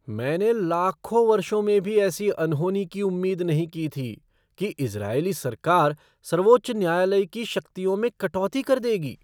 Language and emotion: Hindi, surprised